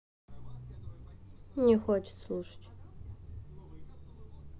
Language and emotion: Russian, neutral